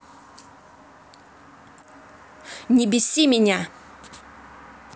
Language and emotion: Russian, angry